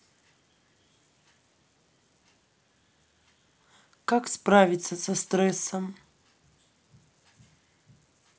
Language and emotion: Russian, neutral